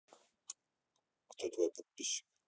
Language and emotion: Russian, neutral